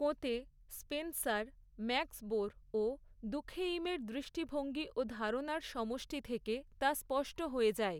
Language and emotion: Bengali, neutral